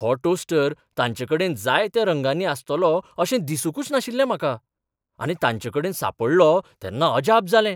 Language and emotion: Goan Konkani, surprised